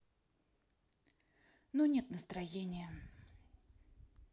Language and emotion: Russian, sad